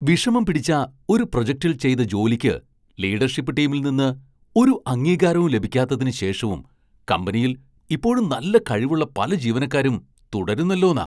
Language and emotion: Malayalam, surprised